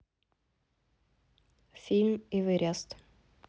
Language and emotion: Russian, neutral